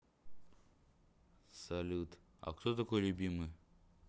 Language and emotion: Russian, neutral